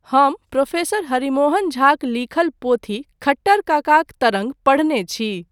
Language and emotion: Maithili, neutral